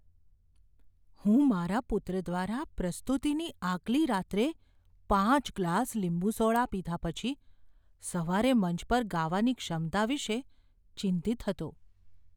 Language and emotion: Gujarati, fearful